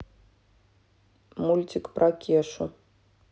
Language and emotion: Russian, neutral